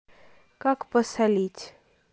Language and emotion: Russian, neutral